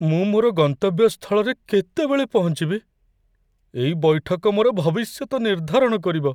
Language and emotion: Odia, fearful